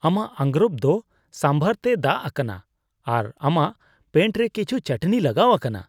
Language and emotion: Santali, disgusted